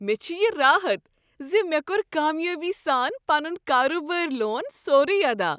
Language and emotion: Kashmiri, happy